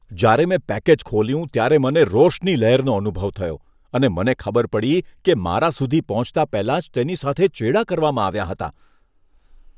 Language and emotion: Gujarati, disgusted